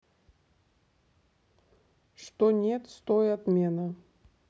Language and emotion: Russian, neutral